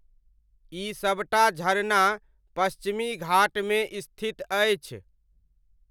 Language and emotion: Maithili, neutral